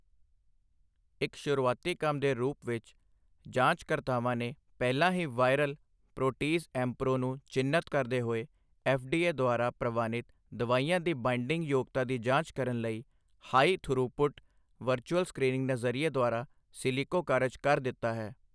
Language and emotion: Punjabi, neutral